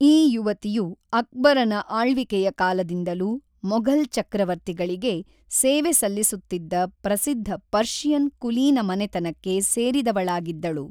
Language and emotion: Kannada, neutral